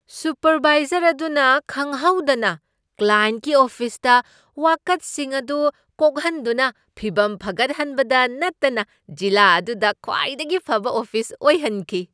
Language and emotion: Manipuri, surprised